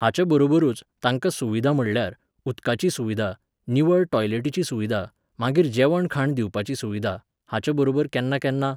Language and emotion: Goan Konkani, neutral